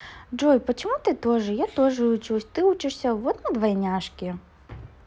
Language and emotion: Russian, positive